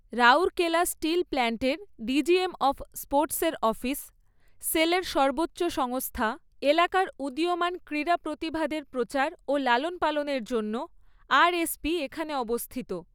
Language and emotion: Bengali, neutral